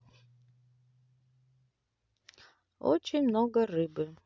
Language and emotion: Russian, neutral